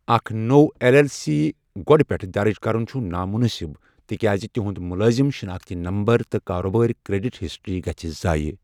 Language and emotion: Kashmiri, neutral